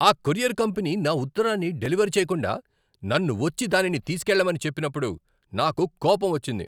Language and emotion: Telugu, angry